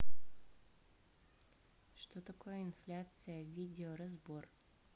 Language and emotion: Russian, neutral